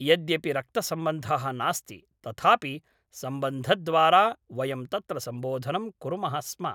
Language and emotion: Sanskrit, neutral